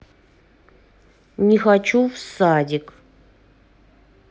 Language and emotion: Russian, sad